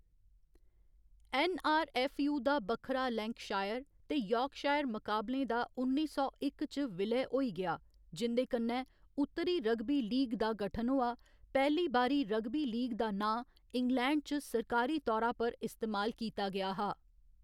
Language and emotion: Dogri, neutral